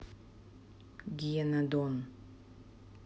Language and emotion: Russian, neutral